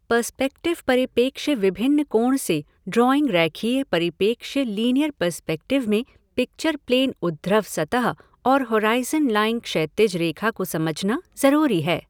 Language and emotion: Hindi, neutral